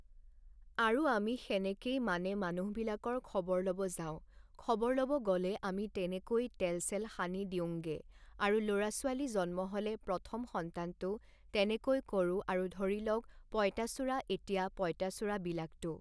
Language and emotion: Assamese, neutral